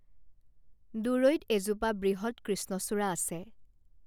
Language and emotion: Assamese, neutral